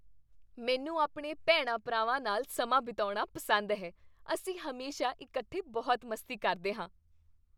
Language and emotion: Punjabi, happy